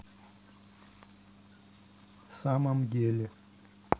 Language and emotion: Russian, neutral